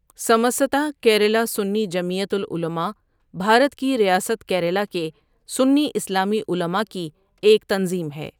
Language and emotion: Urdu, neutral